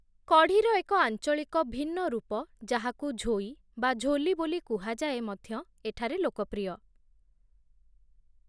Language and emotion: Odia, neutral